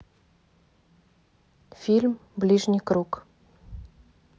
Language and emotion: Russian, neutral